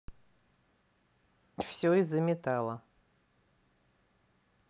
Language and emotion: Russian, neutral